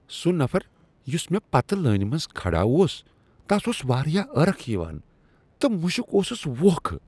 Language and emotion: Kashmiri, disgusted